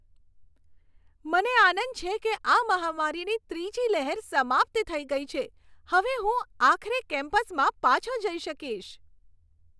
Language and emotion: Gujarati, happy